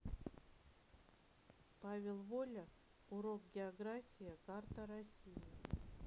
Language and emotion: Russian, neutral